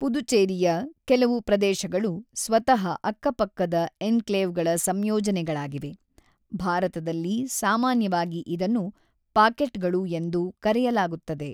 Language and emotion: Kannada, neutral